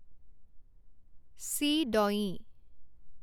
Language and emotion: Assamese, neutral